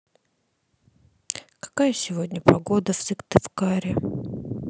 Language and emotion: Russian, sad